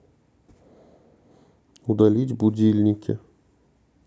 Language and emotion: Russian, neutral